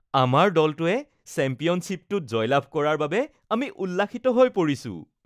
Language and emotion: Assamese, happy